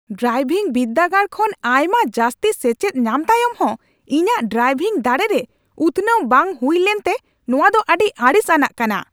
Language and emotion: Santali, angry